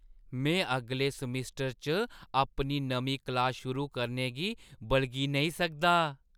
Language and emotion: Dogri, happy